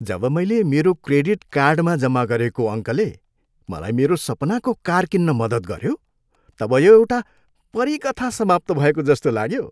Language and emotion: Nepali, happy